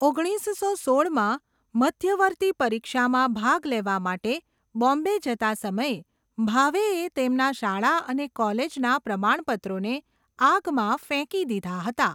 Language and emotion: Gujarati, neutral